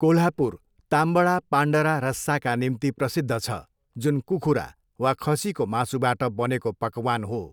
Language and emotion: Nepali, neutral